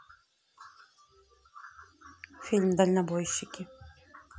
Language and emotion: Russian, neutral